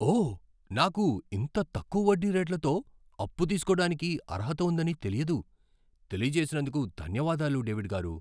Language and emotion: Telugu, surprised